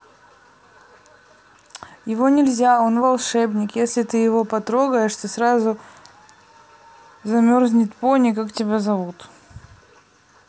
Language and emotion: Russian, neutral